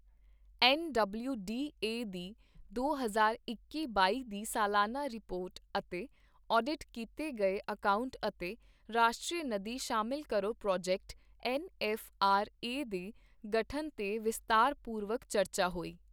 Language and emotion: Punjabi, neutral